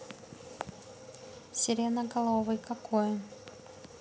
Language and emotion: Russian, neutral